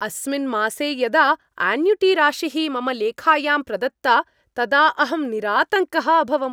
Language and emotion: Sanskrit, happy